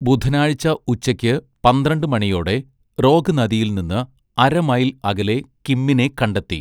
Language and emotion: Malayalam, neutral